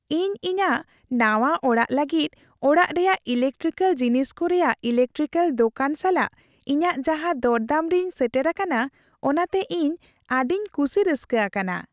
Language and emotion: Santali, happy